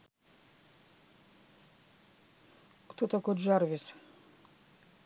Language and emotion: Russian, neutral